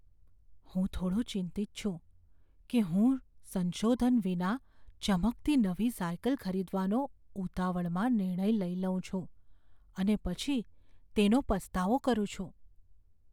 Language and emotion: Gujarati, fearful